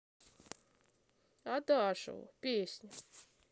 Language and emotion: Russian, sad